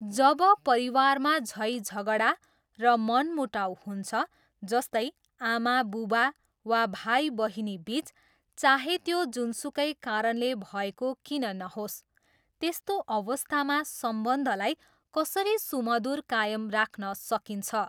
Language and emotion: Nepali, neutral